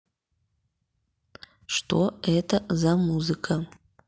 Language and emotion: Russian, neutral